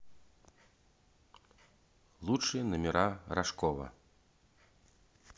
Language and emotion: Russian, neutral